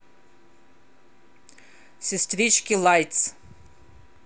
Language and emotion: Russian, angry